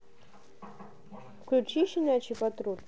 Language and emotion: Russian, neutral